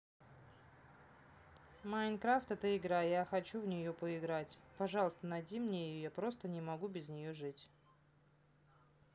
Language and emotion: Russian, neutral